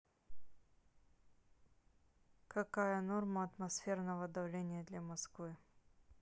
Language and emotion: Russian, neutral